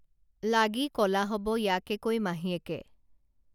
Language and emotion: Assamese, neutral